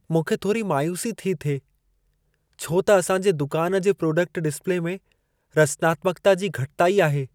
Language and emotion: Sindhi, sad